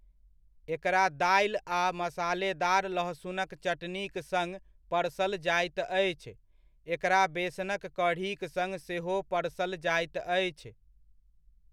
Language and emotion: Maithili, neutral